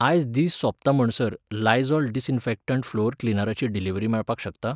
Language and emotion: Goan Konkani, neutral